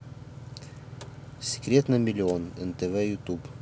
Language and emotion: Russian, neutral